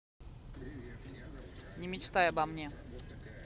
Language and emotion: Russian, angry